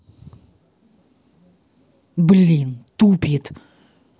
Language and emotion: Russian, angry